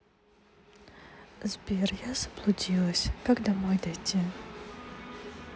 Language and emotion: Russian, sad